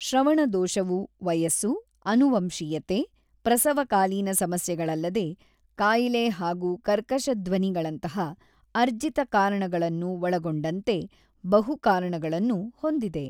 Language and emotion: Kannada, neutral